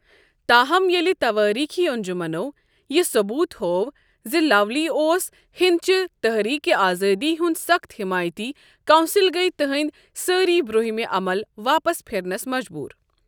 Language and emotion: Kashmiri, neutral